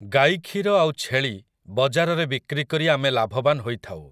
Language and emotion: Odia, neutral